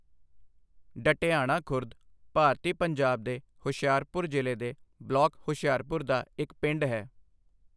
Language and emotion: Punjabi, neutral